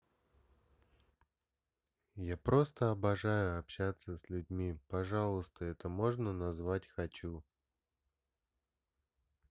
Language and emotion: Russian, sad